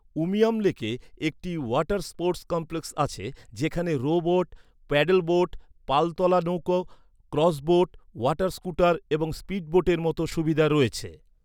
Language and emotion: Bengali, neutral